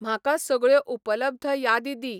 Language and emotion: Goan Konkani, neutral